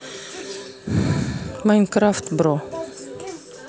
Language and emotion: Russian, neutral